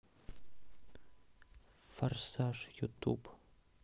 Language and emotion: Russian, neutral